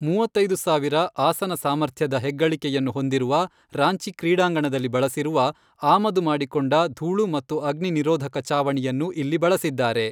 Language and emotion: Kannada, neutral